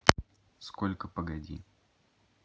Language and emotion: Russian, neutral